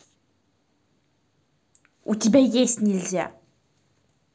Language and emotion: Russian, angry